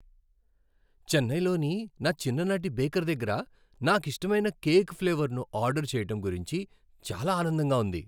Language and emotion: Telugu, happy